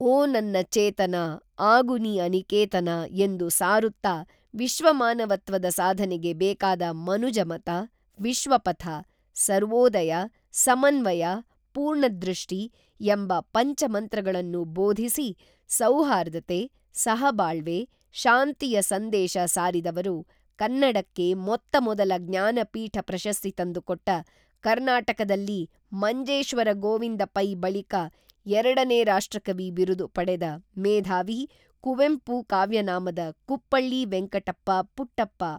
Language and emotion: Kannada, neutral